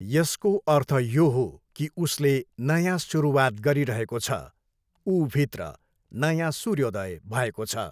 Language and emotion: Nepali, neutral